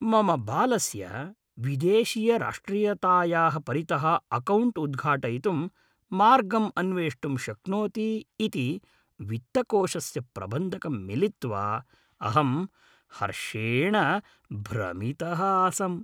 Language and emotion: Sanskrit, happy